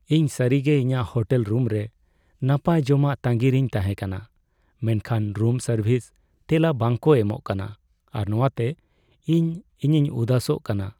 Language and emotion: Santali, sad